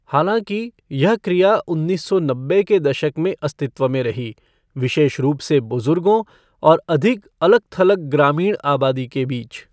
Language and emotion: Hindi, neutral